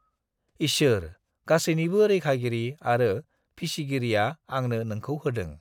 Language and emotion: Bodo, neutral